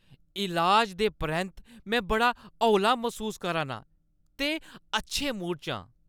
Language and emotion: Dogri, happy